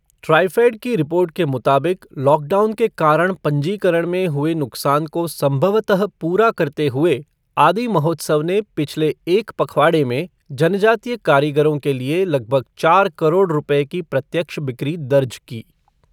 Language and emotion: Hindi, neutral